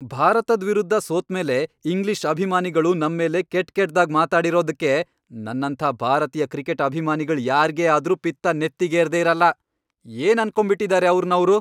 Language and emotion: Kannada, angry